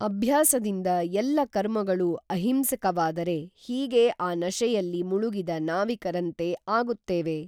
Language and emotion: Kannada, neutral